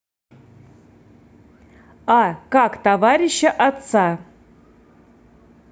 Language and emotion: Russian, neutral